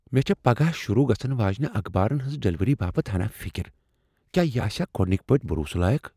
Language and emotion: Kashmiri, fearful